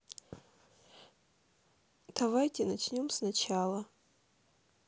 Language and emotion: Russian, sad